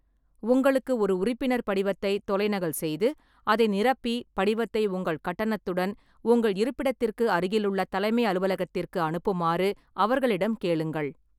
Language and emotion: Tamil, neutral